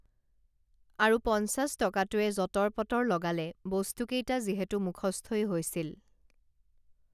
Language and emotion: Assamese, neutral